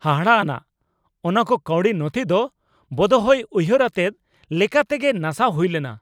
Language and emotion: Santali, angry